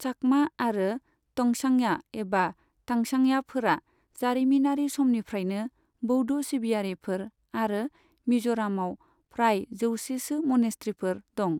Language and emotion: Bodo, neutral